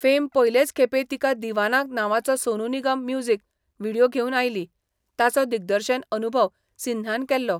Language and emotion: Goan Konkani, neutral